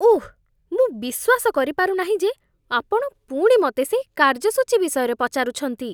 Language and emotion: Odia, disgusted